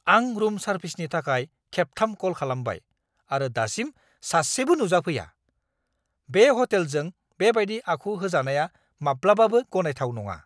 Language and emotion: Bodo, angry